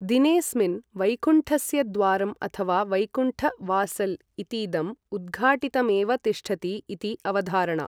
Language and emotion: Sanskrit, neutral